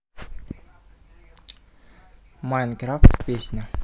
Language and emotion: Russian, neutral